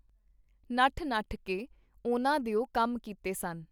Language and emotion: Punjabi, neutral